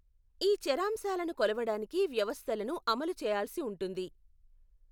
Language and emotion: Telugu, neutral